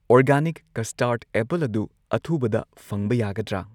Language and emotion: Manipuri, neutral